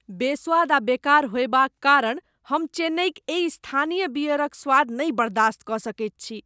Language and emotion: Maithili, disgusted